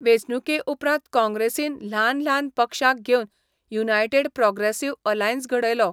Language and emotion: Goan Konkani, neutral